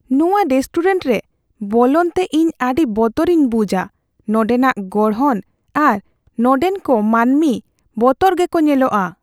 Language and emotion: Santali, fearful